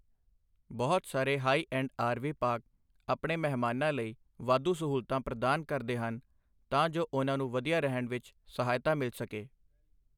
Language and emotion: Punjabi, neutral